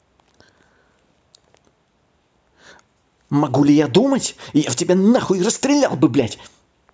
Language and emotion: Russian, angry